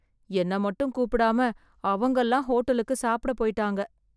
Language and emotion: Tamil, sad